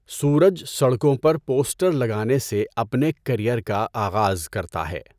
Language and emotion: Urdu, neutral